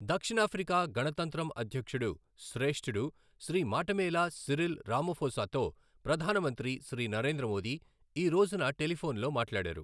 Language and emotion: Telugu, neutral